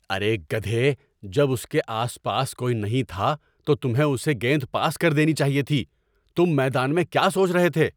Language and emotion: Urdu, angry